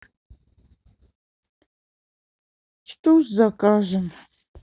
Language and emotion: Russian, sad